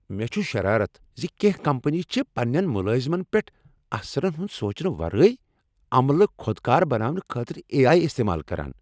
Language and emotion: Kashmiri, angry